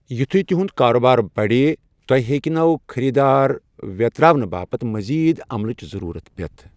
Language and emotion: Kashmiri, neutral